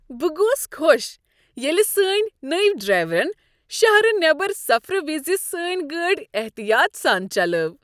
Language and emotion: Kashmiri, happy